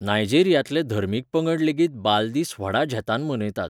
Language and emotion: Goan Konkani, neutral